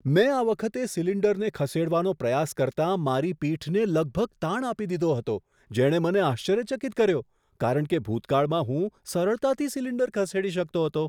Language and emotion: Gujarati, surprised